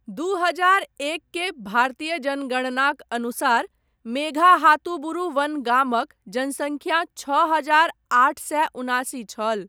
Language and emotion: Maithili, neutral